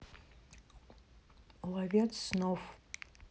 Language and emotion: Russian, neutral